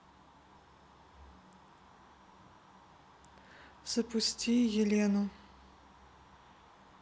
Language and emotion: Russian, neutral